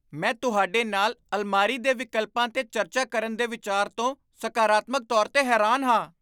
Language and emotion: Punjabi, surprised